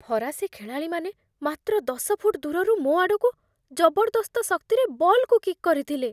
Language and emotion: Odia, fearful